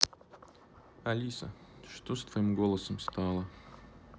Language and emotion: Russian, neutral